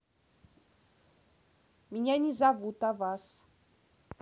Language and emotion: Russian, neutral